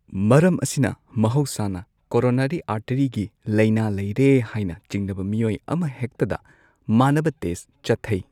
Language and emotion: Manipuri, neutral